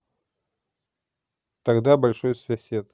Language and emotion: Russian, neutral